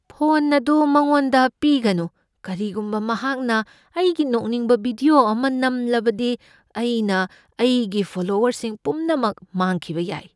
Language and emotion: Manipuri, fearful